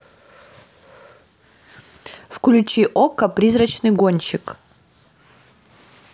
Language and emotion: Russian, neutral